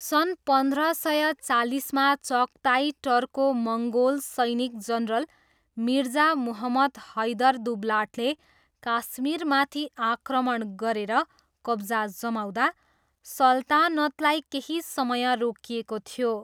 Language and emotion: Nepali, neutral